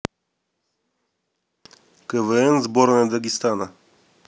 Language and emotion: Russian, neutral